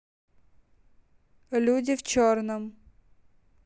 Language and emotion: Russian, neutral